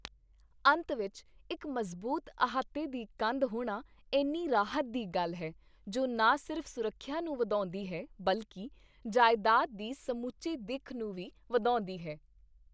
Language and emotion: Punjabi, happy